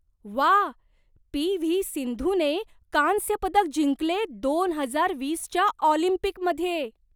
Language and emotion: Marathi, surprised